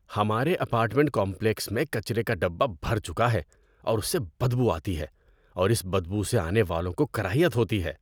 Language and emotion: Urdu, disgusted